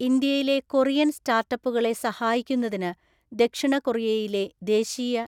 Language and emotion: Malayalam, neutral